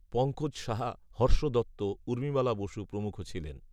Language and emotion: Bengali, neutral